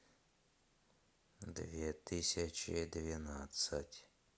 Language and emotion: Russian, neutral